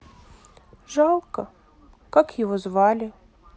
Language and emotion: Russian, sad